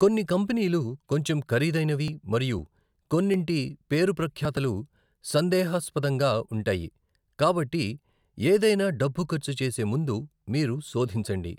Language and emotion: Telugu, neutral